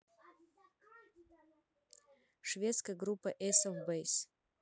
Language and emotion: Russian, neutral